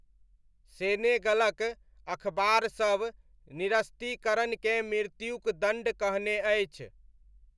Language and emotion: Maithili, neutral